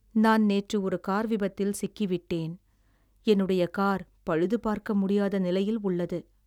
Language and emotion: Tamil, sad